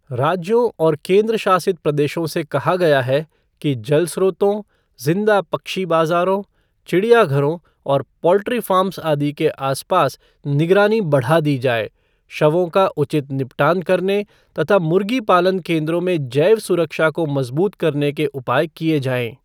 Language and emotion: Hindi, neutral